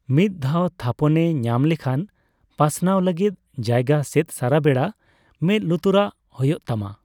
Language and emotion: Santali, neutral